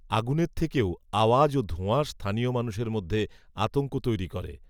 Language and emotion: Bengali, neutral